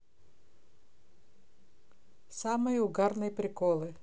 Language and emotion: Russian, neutral